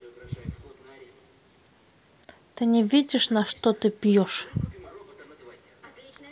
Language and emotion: Russian, neutral